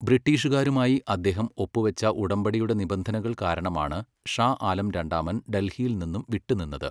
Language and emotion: Malayalam, neutral